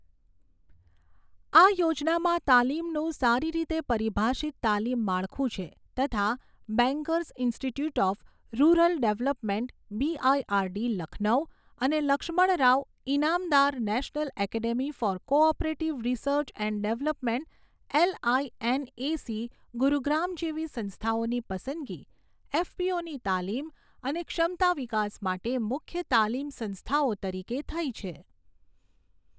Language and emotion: Gujarati, neutral